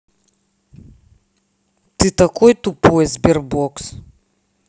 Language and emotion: Russian, angry